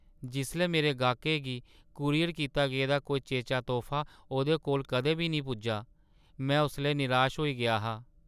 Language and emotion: Dogri, sad